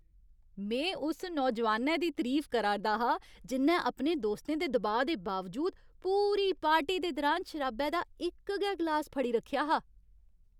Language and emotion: Dogri, happy